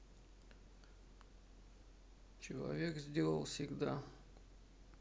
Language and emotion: Russian, sad